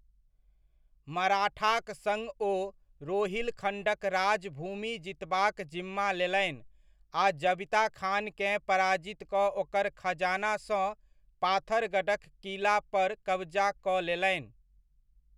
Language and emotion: Maithili, neutral